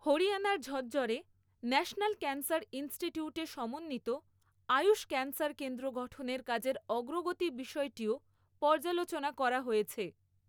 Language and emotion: Bengali, neutral